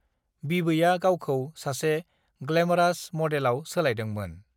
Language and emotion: Bodo, neutral